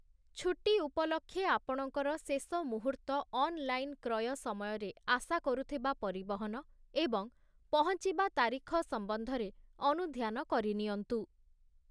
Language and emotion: Odia, neutral